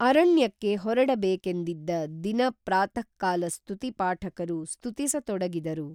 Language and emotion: Kannada, neutral